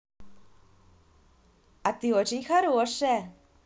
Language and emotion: Russian, positive